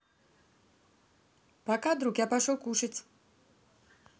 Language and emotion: Russian, positive